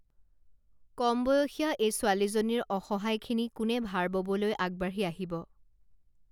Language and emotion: Assamese, neutral